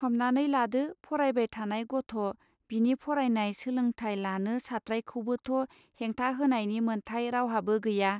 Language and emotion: Bodo, neutral